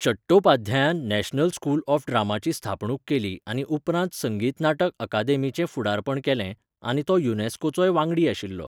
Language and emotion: Goan Konkani, neutral